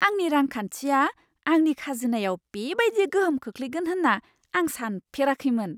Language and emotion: Bodo, surprised